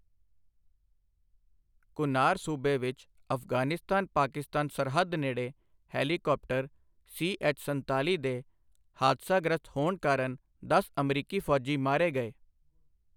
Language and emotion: Punjabi, neutral